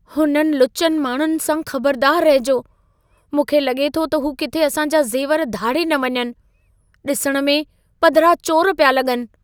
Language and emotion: Sindhi, fearful